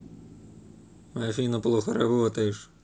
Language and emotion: Russian, angry